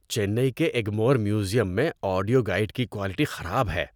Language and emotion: Urdu, disgusted